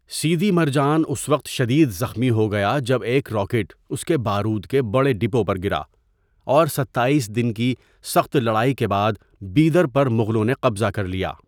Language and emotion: Urdu, neutral